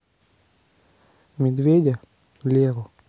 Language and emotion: Russian, neutral